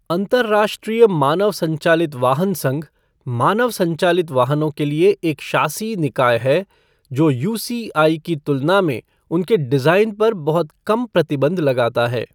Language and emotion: Hindi, neutral